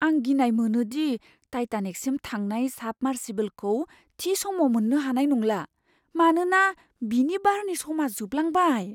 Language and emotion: Bodo, fearful